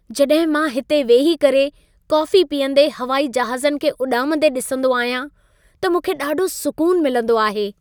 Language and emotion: Sindhi, happy